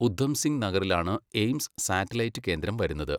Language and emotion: Malayalam, neutral